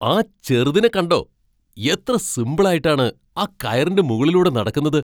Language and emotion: Malayalam, surprised